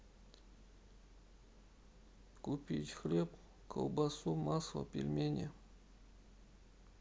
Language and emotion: Russian, sad